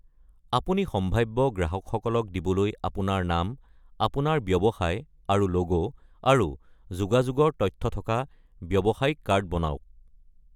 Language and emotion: Assamese, neutral